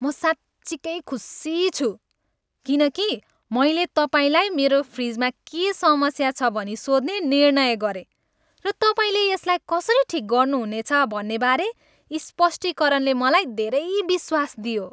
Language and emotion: Nepali, happy